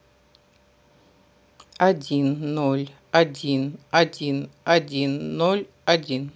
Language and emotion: Russian, neutral